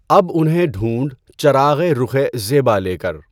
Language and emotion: Urdu, neutral